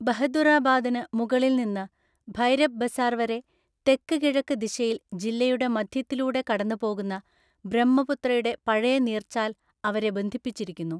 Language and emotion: Malayalam, neutral